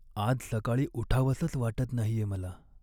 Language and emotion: Marathi, sad